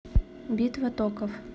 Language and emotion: Russian, neutral